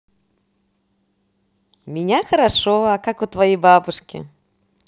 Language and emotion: Russian, positive